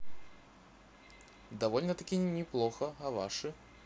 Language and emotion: Russian, positive